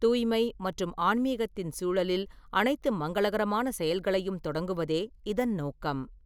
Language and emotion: Tamil, neutral